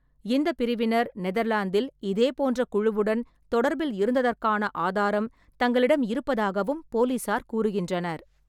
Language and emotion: Tamil, neutral